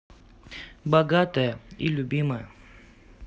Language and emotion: Russian, neutral